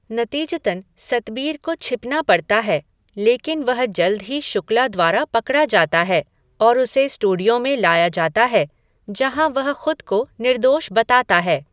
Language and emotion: Hindi, neutral